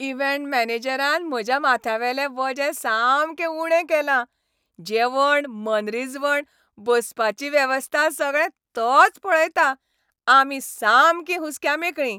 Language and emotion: Goan Konkani, happy